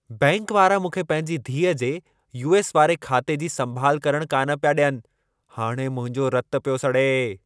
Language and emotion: Sindhi, angry